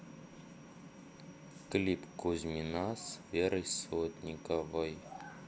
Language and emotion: Russian, neutral